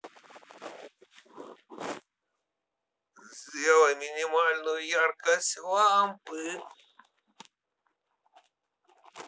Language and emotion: Russian, positive